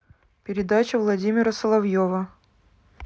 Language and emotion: Russian, neutral